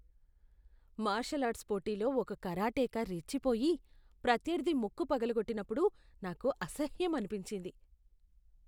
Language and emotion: Telugu, disgusted